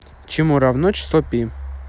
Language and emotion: Russian, neutral